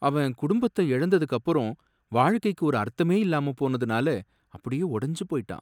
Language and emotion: Tamil, sad